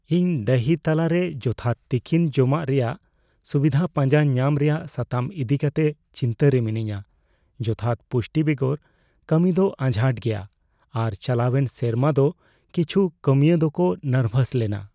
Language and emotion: Santali, fearful